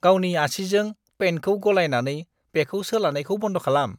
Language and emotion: Bodo, disgusted